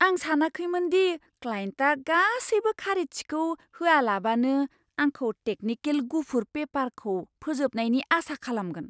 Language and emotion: Bodo, surprised